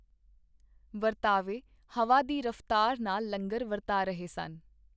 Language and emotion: Punjabi, neutral